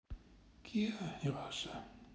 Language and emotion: Russian, sad